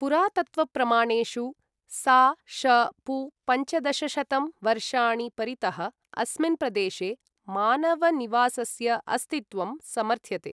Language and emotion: Sanskrit, neutral